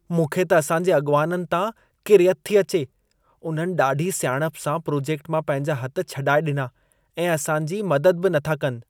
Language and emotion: Sindhi, disgusted